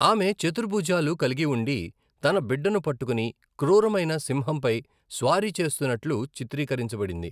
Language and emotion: Telugu, neutral